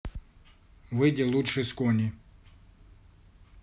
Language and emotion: Russian, neutral